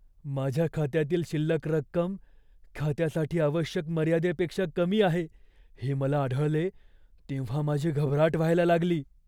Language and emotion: Marathi, fearful